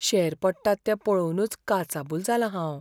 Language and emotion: Goan Konkani, fearful